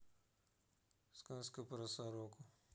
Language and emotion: Russian, neutral